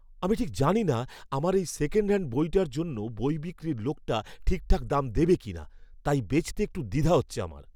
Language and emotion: Bengali, fearful